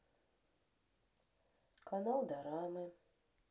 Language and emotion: Russian, sad